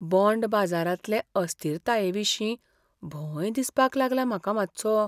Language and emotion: Goan Konkani, fearful